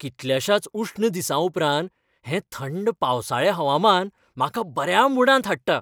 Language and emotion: Goan Konkani, happy